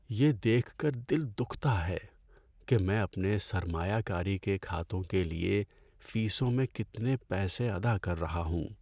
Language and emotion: Urdu, sad